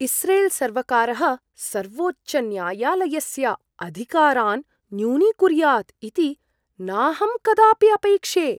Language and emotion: Sanskrit, surprised